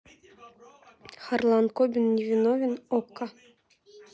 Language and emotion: Russian, neutral